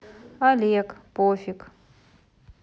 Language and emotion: Russian, neutral